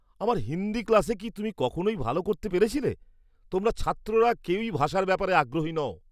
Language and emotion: Bengali, disgusted